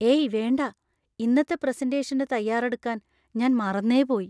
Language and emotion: Malayalam, fearful